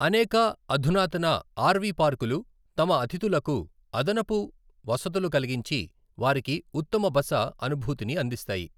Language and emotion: Telugu, neutral